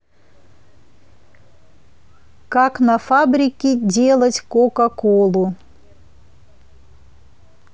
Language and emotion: Russian, neutral